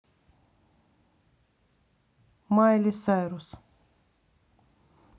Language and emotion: Russian, neutral